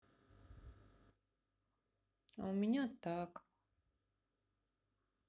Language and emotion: Russian, sad